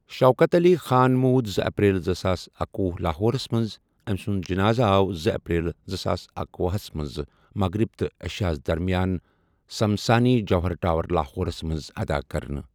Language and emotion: Kashmiri, neutral